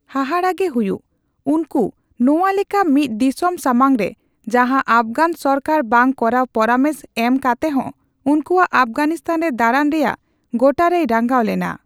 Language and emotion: Santali, neutral